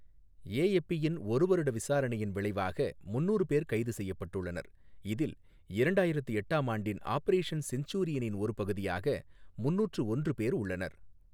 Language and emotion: Tamil, neutral